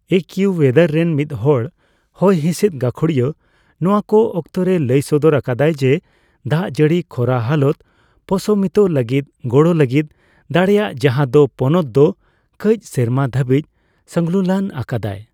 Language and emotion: Santali, neutral